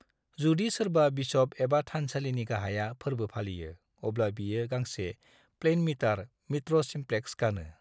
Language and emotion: Bodo, neutral